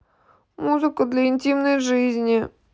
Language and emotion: Russian, sad